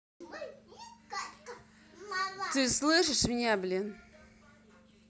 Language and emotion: Russian, angry